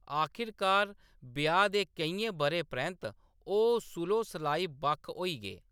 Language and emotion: Dogri, neutral